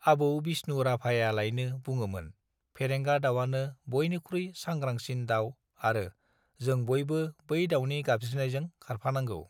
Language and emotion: Bodo, neutral